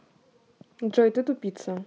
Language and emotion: Russian, neutral